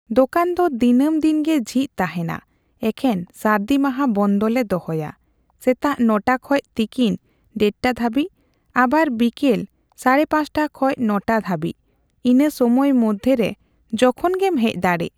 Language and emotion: Santali, neutral